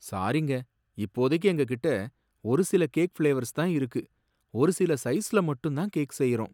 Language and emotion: Tamil, sad